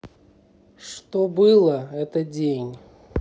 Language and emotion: Russian, neutral